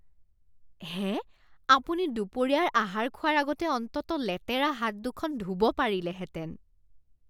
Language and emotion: Assamese, disgusted